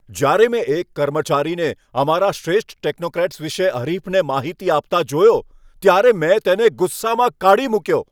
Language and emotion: Gujarati, angry